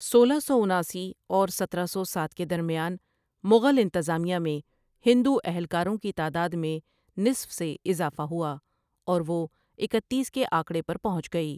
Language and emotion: Urdu, neutral